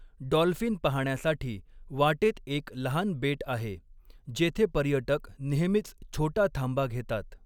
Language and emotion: Marathi, neutral